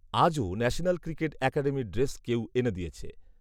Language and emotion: Bengali, neutral